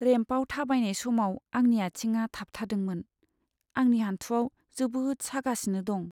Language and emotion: Bodo, sad